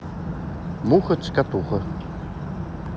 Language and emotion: Russian, neutral